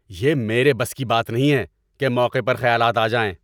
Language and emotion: Urdu, angry